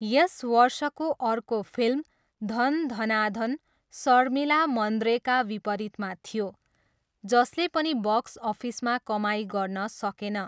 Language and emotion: Nepali, neutral